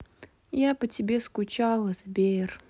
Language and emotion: Russian, sad